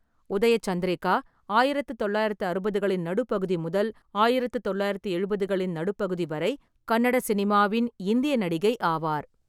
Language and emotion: Tamil, neutral